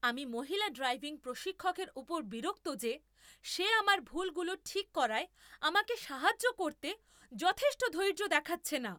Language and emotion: Bengali, angry